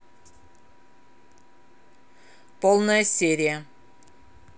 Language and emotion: Russian, neutral